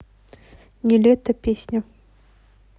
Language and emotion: Russian, neutral